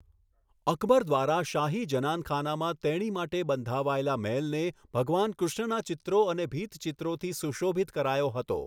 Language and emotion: Gujarati, neutral